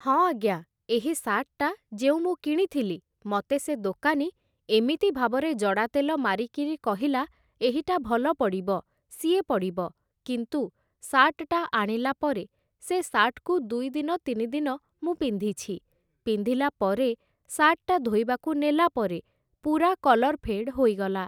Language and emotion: Odia, neutral